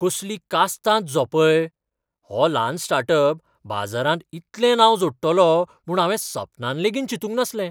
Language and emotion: Goan Konkani, surprised